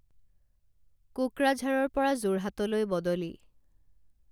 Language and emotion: Assamese, neutral